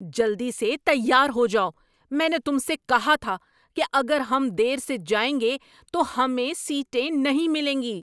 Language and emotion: Urdu, angry